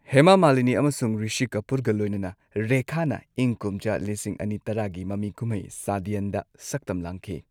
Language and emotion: Manipuri, neutral